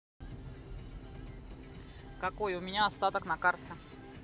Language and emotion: Russian, neutral